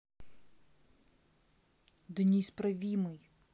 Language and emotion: Russian, angry